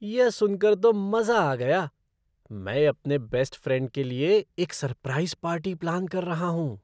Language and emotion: Hindi, surprised